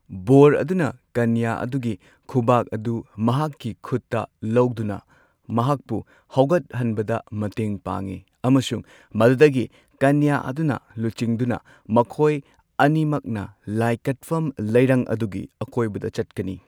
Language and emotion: Manipuri, neutral